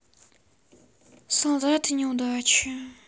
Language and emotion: Russian, sad